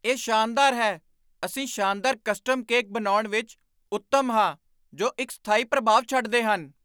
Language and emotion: Punjabi, surprised